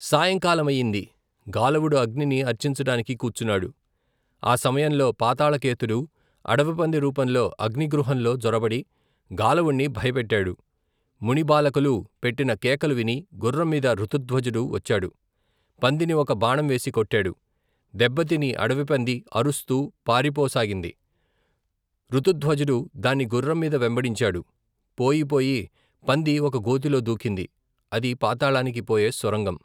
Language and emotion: Telugu, neutral